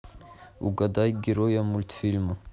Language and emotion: Russian, neutral